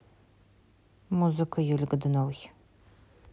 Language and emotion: Russian, neutral